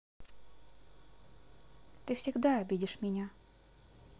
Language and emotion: Russian, sad